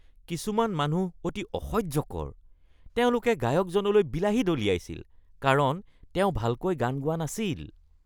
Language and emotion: Assamese, disgusted